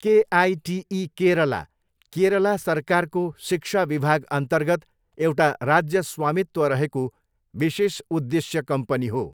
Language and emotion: Nepali, neutral